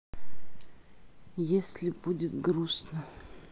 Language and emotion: Russian, sad